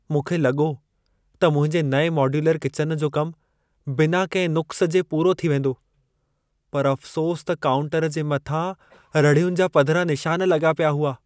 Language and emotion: Sindhi, sad